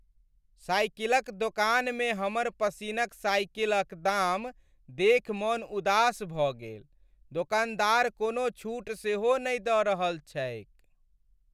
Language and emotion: Maithili, sad